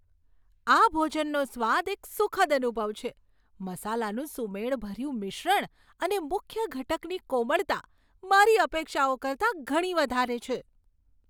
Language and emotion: Gujarati, surprised